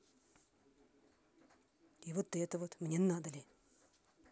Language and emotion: Russian, angry